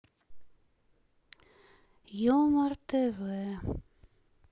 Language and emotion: Russian, sad